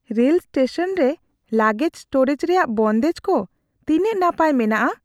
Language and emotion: Santali, fearful